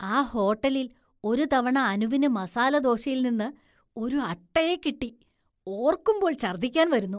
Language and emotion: Malayalam, disgusted